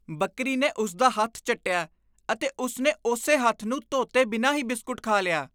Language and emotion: Punjabi, disgusted